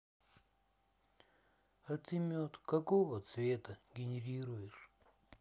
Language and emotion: Russian, sad